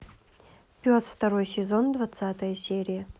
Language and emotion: Russian, neutral